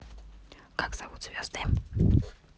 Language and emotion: Russian, neutral